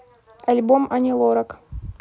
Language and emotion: Russian, neutral